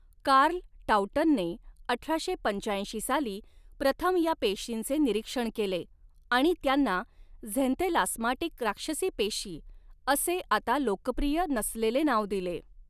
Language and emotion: Marathi, neutral